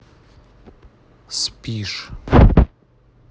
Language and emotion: Russian, neutral